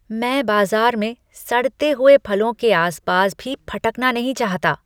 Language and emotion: Hindi, disgusted